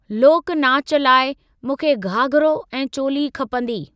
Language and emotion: Sindhi, neutral